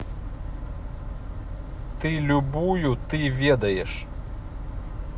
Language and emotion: Russian, neutral